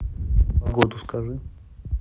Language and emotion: Russian, neutral